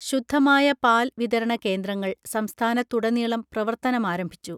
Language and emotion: Malayalam, neutral